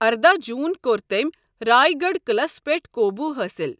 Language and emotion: Kashmiri, neutral